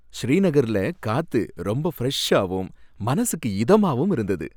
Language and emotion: Tamil, happy